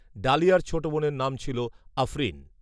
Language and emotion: Bengali, neutral